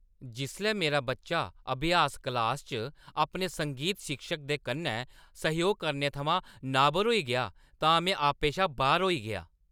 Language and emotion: Dogri, angry